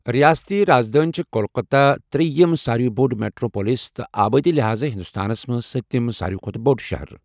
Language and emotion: Kashmiri, neutral